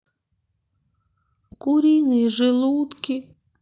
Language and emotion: Russian, sad